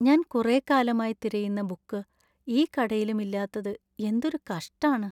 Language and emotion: Malayalam, sad